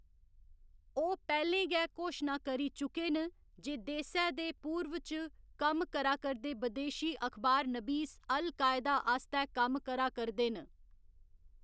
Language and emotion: Dogri, neutral